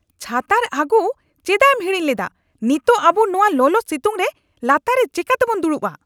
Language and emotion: Santali, angry